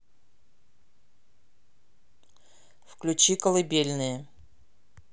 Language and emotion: Russian, neutral